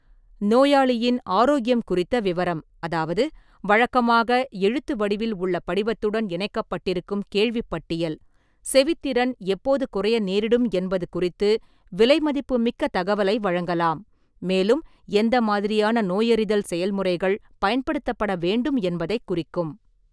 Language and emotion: Tamil, neutral